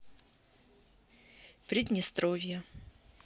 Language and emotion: Russian, neutral